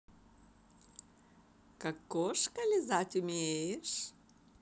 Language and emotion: Russian, positive